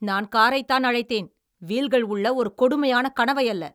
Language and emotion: Tamil, angry